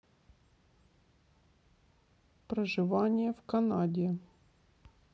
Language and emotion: Russian, neutral